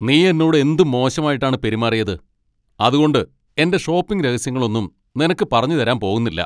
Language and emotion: Malayalam, angry